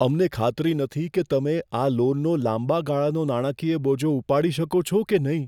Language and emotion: Gujarati, fearful